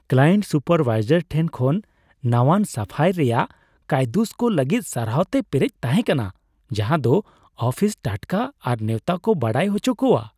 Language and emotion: Santali, happy